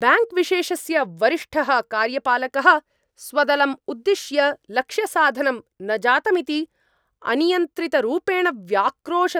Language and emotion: Sanskrit, angry